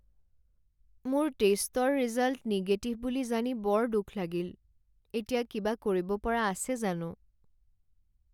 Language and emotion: Assamese, sad